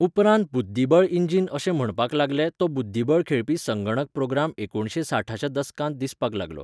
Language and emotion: Goan Konkani, neutral